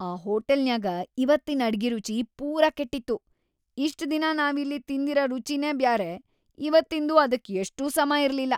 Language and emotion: Kannada, disgusted